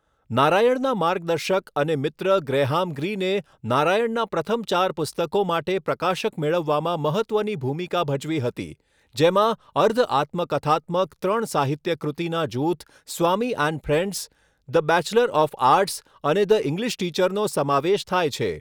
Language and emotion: Gujarati, neutral